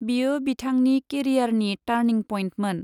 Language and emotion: Bodo, neutral